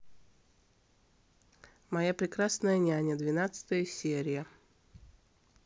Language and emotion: Russian, neutral